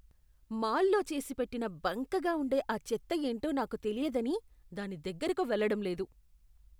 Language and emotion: Telugu, disgusted